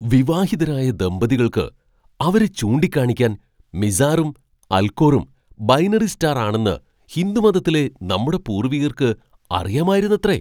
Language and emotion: Malayalam, surprised